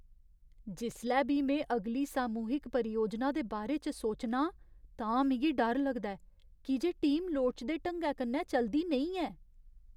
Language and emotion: Dogri, fearful